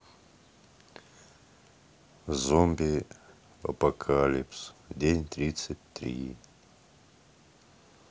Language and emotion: Russian, sad